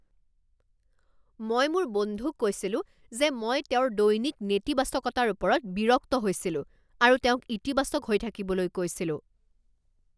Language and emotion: Assamese, angry